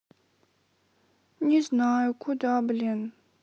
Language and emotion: Russian, sad